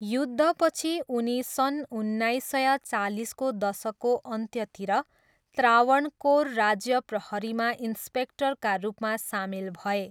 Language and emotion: Nepali, neutral